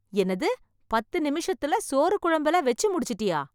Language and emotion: Tamil, surprised